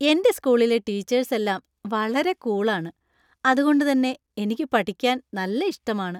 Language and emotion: Malayalam, happy